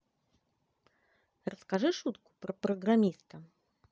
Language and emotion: Russian, positive